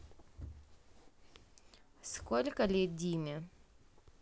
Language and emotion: Russian, neutral